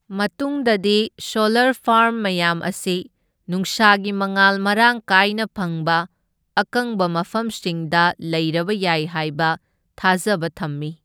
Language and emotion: Manipuri, neutral